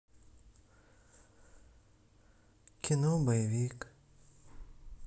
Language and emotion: Russian, sad